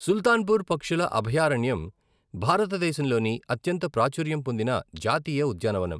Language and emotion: Telugu, neutral